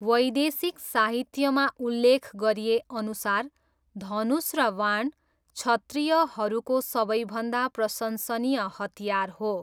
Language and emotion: Nepali, neutral